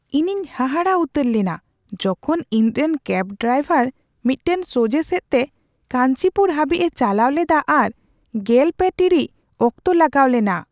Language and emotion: Santali, surprised